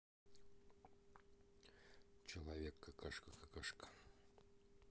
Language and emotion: Russian, neutral